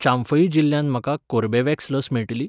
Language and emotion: Goan Konkani, neutral